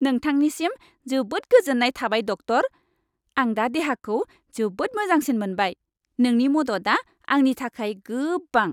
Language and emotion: Bodo, happy